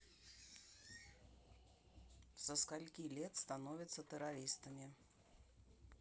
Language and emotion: Russian, neutral